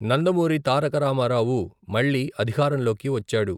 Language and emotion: Telugu, neutral